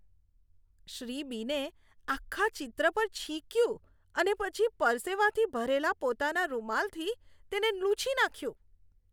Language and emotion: Gujarati, disgusted